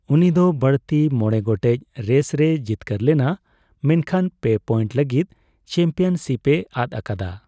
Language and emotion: Santali, neutral